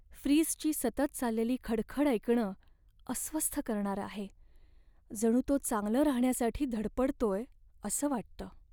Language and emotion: Marathi, sad